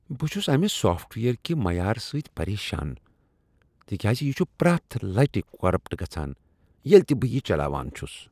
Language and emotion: Kashmiri, disgusted